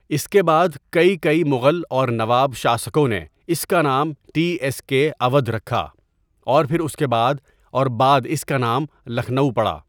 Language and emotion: Urdu, neutral